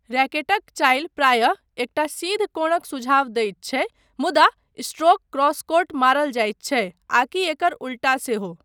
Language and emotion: Maithili, neutral